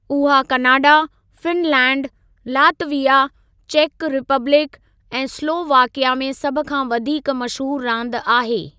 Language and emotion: Sindhi, neutral